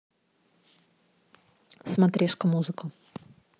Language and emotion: Russian, neutral